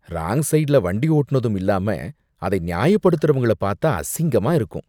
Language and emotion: Tamil, disgusted